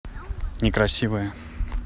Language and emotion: Russian, neutral